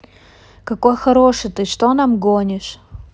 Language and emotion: Russian, neutral